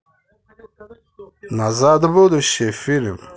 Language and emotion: Russian, positive